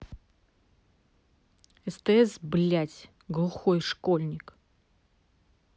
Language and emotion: Russian, angry